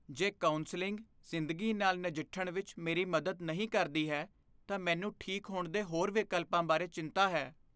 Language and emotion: Punjabi, fearful